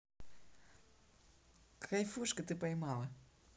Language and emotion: Russian, neutral